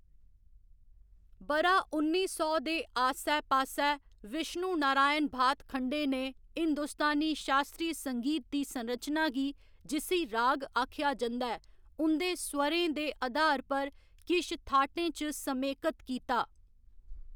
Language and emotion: Dogri, neutral